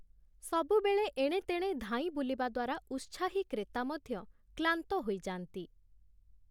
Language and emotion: Odia, neutral